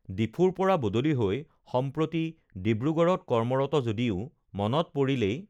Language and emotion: Assamese, neutral